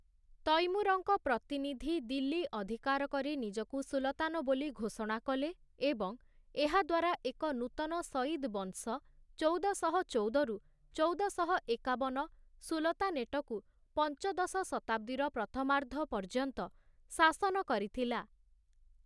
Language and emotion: Odia, neutral